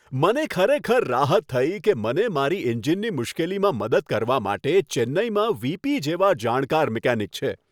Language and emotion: Gujarati, happy